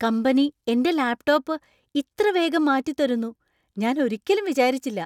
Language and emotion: Malayalam, surprised